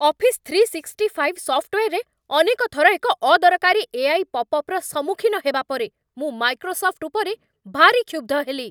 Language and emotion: Odia, angry